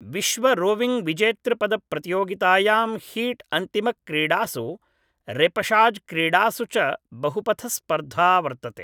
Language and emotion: Sanskrit, neutral